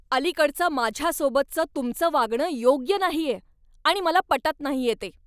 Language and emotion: Marathi, angry